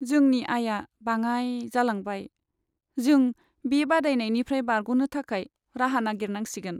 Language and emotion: Bodo, sad